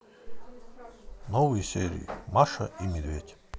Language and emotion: Russian, neutral